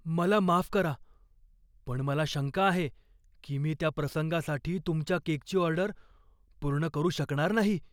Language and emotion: Marathi, fearful